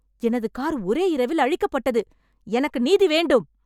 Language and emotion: Tamil, angry